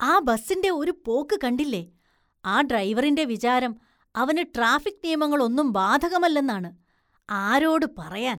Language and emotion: Malayalam, disgusted